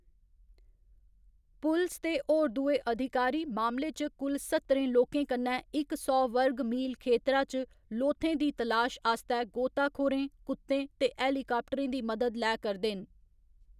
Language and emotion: Dogri, neutral